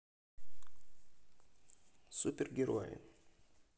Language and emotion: Russian, neutral